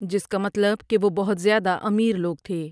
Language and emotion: Urdu, neutral